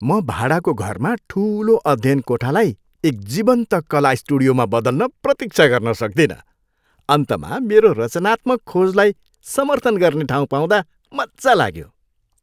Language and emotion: Nepali, happy